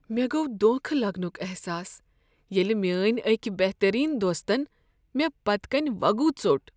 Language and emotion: Kashmiri, sad